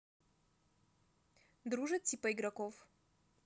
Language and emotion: Russian, neutral